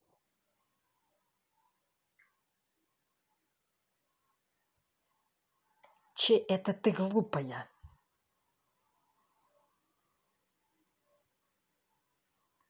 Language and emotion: Russian, angry